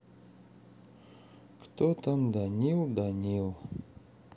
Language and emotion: Russian, sad